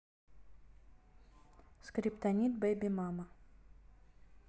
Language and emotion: Russian, neutral